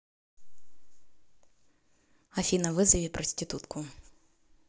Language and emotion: Russian, neutral